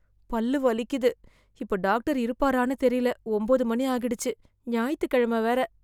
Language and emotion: Tamil, fearful